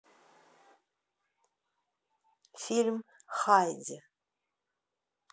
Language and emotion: Russian, neutral